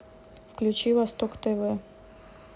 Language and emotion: Russian, neutral